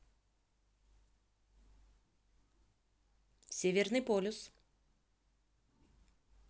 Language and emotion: Russian, neutral